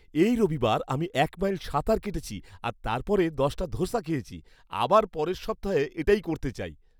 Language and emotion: Bengali, happy